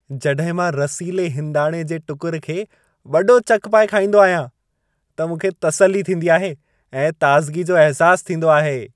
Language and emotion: Sindhi, happy